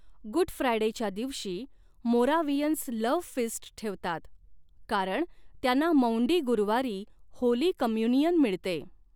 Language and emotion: Marathi, neutral